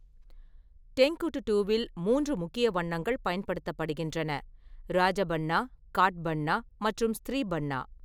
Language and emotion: Tamil, neutral